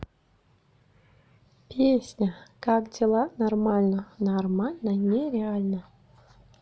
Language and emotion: Russian, neutral